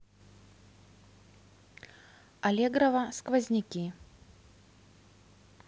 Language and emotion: Russian, neutral